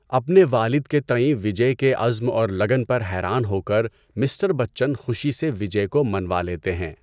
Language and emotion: Urdu, neutral